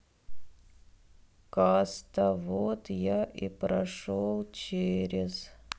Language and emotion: Russian, sad